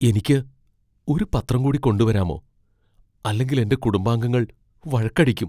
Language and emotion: Malayalam, fearful